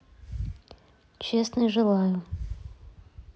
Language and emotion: Russian, neutral